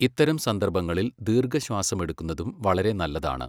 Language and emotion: Malayalam, neutral